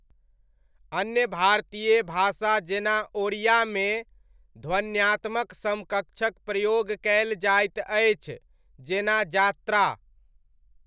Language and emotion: Maithili, neutral